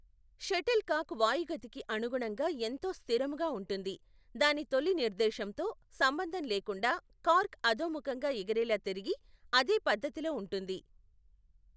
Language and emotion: Telugu, neutral